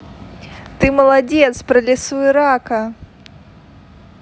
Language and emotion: Russian, positive